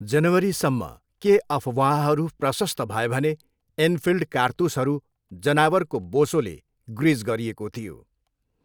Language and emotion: Nepali, neutral